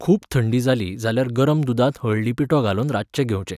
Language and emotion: Goan Konkani, neutral